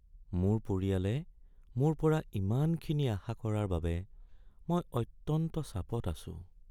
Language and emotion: Assamese, sad